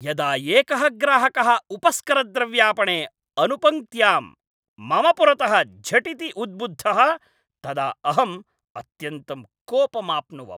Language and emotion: Sanskrit, angry